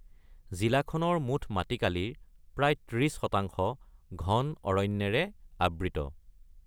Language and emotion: Assamese, neutral